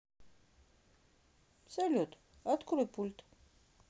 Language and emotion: Russian, neutral